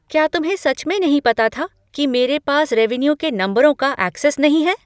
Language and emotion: Hindi, surprised